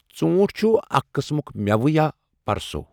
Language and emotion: Kashmiri, neutral